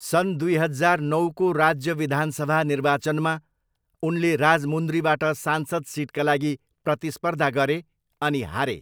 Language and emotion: Nepali, neutral